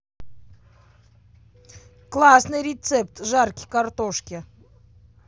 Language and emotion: Russian, positive